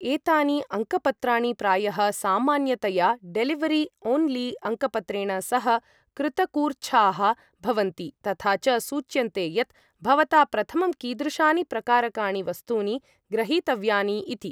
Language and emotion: Sanskrit, neutral